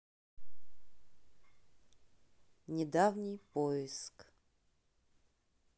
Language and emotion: Russian, neutral